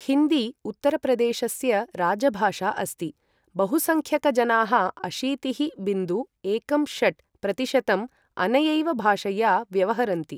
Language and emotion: Sanskrit, neutral